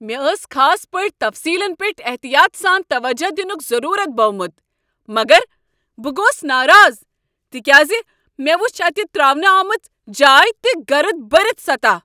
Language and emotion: Kashmiri, angry